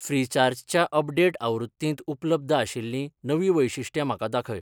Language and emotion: Goan Konkani, neutral